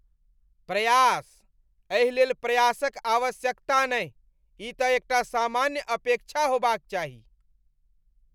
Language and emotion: Maithili, disgusted